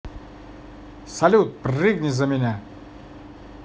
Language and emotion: Russian, positive